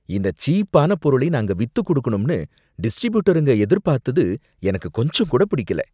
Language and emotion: Tamil, disgusted